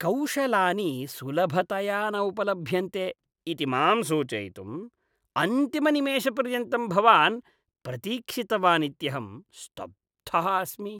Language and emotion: Sanskrit, disgusted